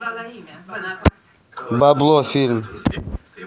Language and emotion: Russian, neutral